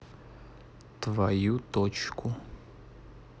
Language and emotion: Russian, neutral